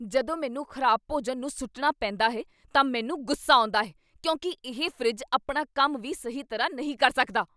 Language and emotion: Punjabi, angry